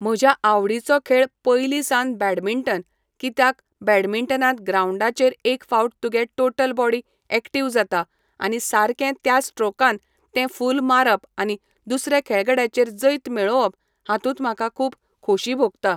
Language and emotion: Goan Konkani, neutral